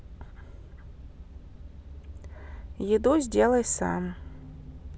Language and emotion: Russian, neutral